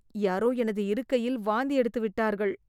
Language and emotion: Tamil, disgusted